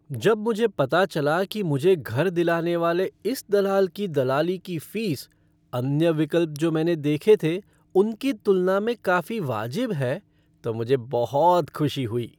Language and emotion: Hindi, happy